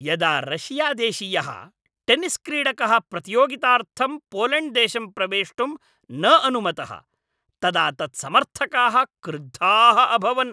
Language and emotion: Sanskrit, angry